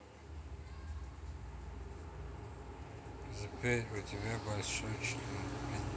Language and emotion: Russian, neutral